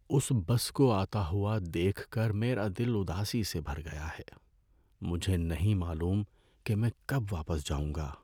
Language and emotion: Urdu, sad